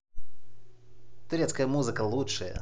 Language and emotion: Russian, positive